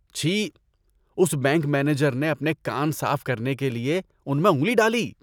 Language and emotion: Urdu, disgusted